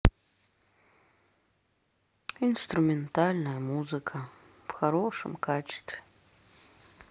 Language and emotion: Russian, sad